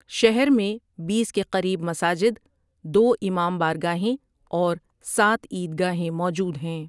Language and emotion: Urdu, neutral